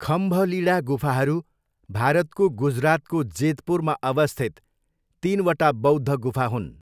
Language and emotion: Nepali, neutral